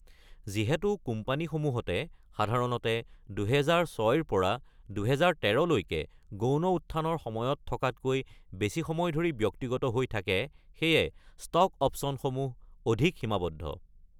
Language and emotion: Assamese, neutral